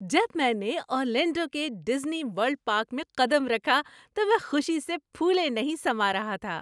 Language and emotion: Urdu, happy